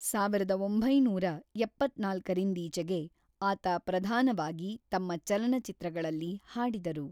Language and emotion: Kannada, neutral